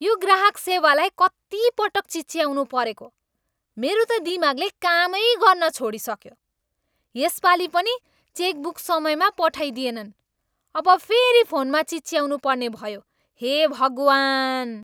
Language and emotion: Nepali, angry